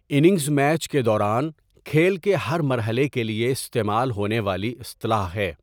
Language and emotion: Urdu, neutral